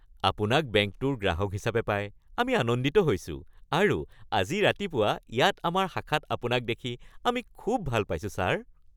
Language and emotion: Assamese, happy